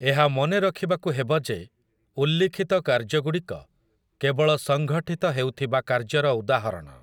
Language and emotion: Odia, neutral